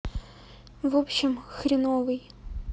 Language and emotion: Russian, sad